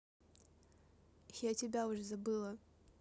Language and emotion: Russian, neutral